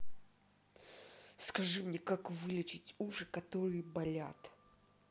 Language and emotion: Russian, angry